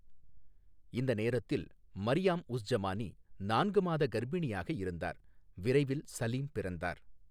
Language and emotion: Tamil, neutral